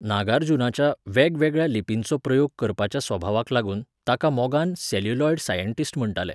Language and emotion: Goan Konkani, neutral